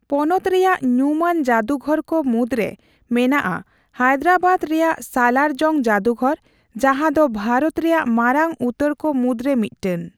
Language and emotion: Santali, neutral